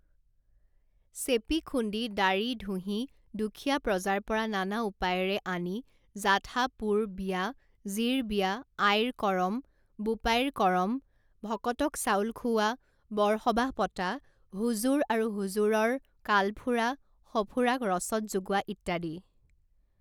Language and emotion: Assamese, neutral